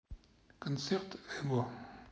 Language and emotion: Russian, neutral